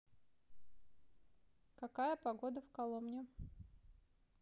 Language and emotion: Russian, neutral